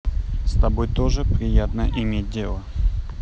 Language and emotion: Russian, neutral